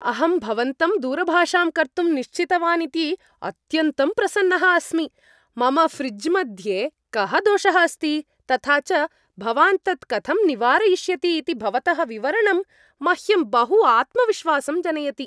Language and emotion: Sanskrit, happy